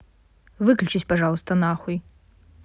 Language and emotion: Russian, neutral